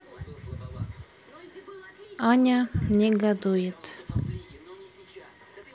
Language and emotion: Russian, neutral